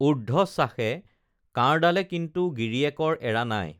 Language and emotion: Assamese, neutral